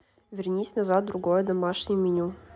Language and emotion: Russian, neutral